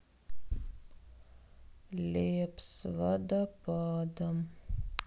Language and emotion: Russian, sad